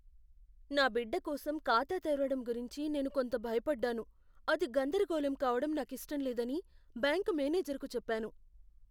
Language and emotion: Telugu, fearful